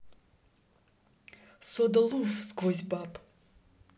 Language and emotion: Russian, neutral